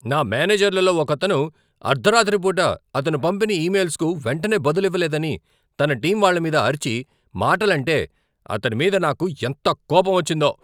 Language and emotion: Telugu, angry